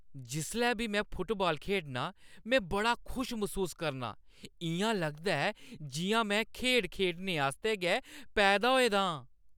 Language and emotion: Dogri, happy